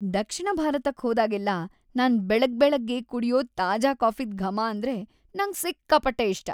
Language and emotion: Kannada, happy